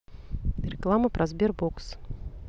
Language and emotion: Russian, neutral